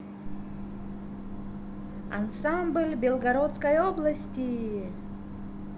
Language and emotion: Russian, positive